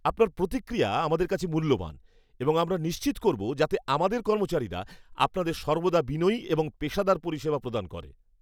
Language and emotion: Bengali, happy